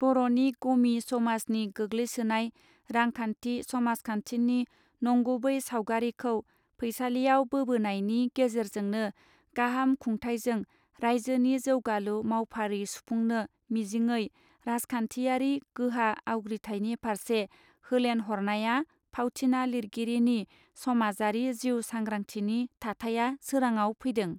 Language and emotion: Bodo, neutral